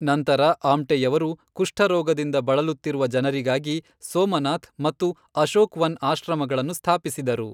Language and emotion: Kannada, neutral